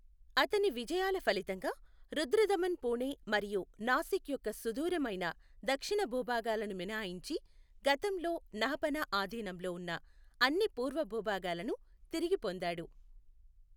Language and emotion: Telugu, neutral